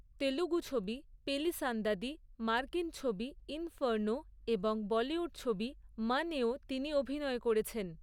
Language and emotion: Bengali, neutral